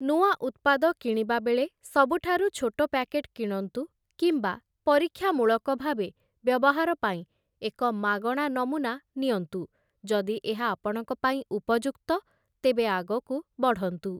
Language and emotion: Odia, neutral